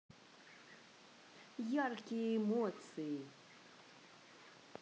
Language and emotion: Russian, positive